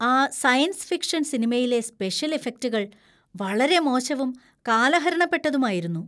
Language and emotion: Malayalam, disgusted